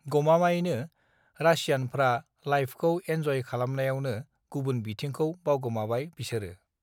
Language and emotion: Bodo, neutral